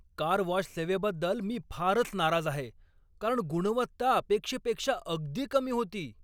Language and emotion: Marathi, angry